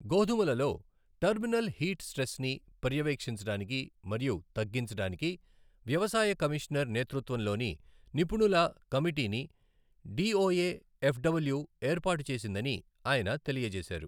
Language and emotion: Telugu, neutral